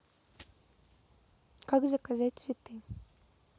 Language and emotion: Russian, neutral